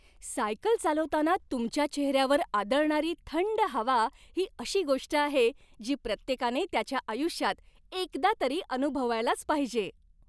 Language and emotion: Marathi, happy